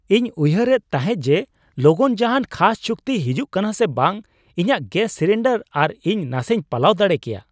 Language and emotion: Santali, surprised